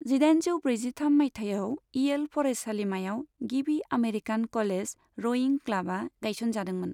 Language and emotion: Bodo, neutral